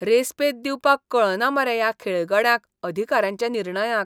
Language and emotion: Goan Konkani, disgusted